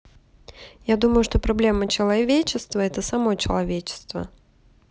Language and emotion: Russian, neutral